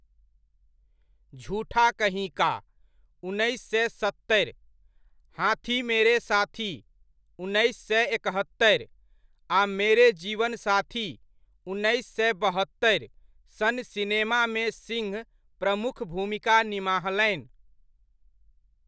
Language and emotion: Maithili, neutral